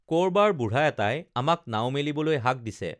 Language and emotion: Assamese, neutral